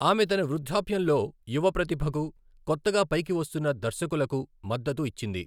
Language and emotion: Telugu, neutral